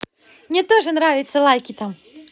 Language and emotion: Russian, positive